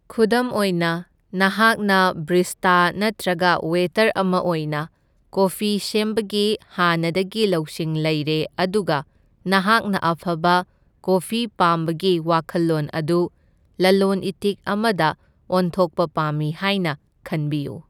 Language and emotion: Manipuri, neutral